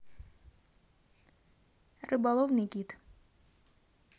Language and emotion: Russian, neutral